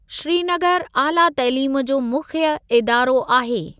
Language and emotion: Sindhi, neutral